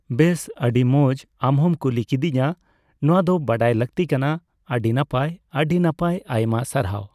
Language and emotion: Santali, neutral